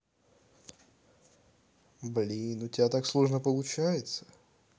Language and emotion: Russian, neutral